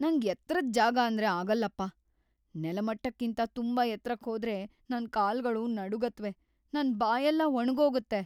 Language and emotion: Kannada, fearful